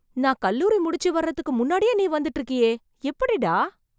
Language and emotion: Tamil, surprised